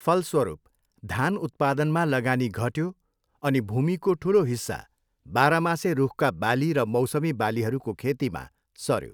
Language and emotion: Nepali, neutral